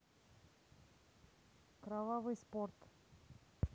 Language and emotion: Russian, neutral